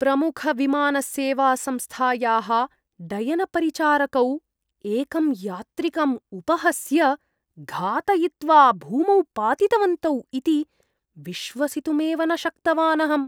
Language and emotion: Sanskrit, disgusted